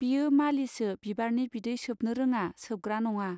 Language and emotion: Bodo, neutral